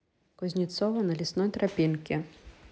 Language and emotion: Russian, neutral